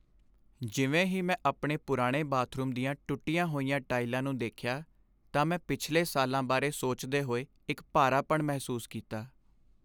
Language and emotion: Punjabi, sad